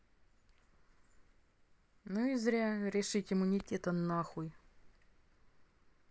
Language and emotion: Russian, angry